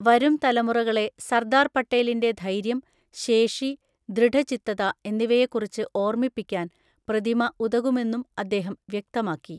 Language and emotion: Malayalam, neutral